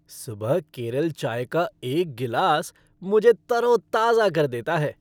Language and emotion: Hindi, happy